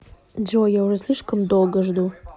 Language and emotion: Russian, neutral